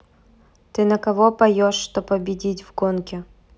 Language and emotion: Russian, neutral